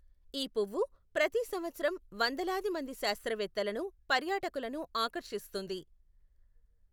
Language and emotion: Telugu, neutral